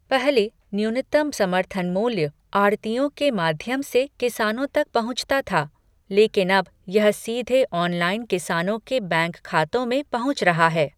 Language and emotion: Hindi, neutral